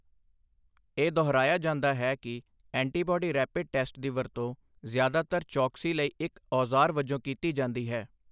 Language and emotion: Punjabi, neutral